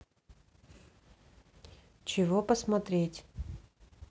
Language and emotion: Russian, neutral